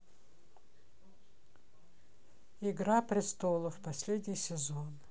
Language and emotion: Russian, neutral